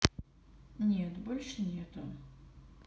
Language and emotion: Russian, neutral